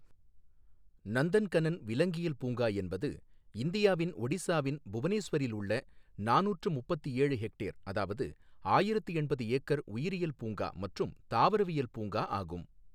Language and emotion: Tamil, neutral